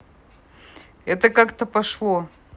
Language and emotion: Russian, neutral